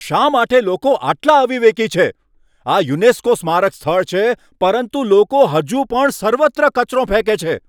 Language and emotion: Gujarati, angry